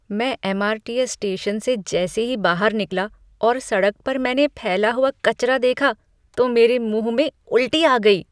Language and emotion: Hindi, disgusted